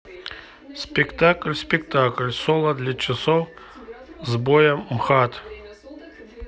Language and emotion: Russian, neutral